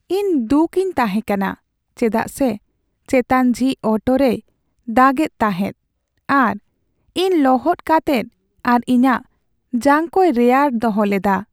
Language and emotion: Santali, sad